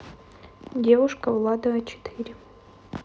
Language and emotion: Russian, neutral